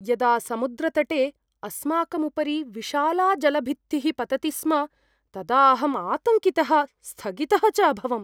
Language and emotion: Sanskrit, fearful